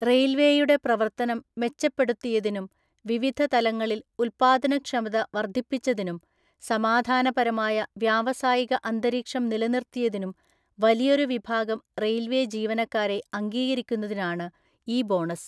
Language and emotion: Malayalam, neutral